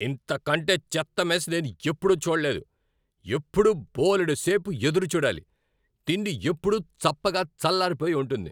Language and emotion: Telugu, angry